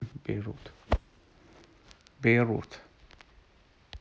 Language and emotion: Russian, neutral